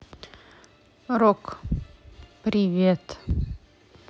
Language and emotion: Russian, neutral